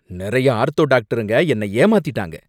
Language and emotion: Tamil, angry